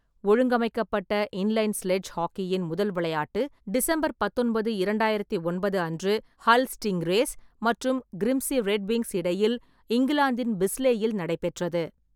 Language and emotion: Tamil, neutral